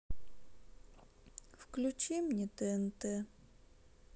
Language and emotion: Russian, sad